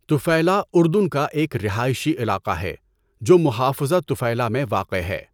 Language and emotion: Urdu, neutral